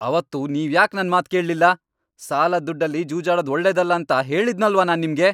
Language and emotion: Kannada, angry